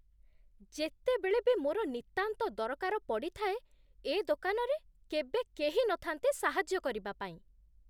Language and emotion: Odia, disgusted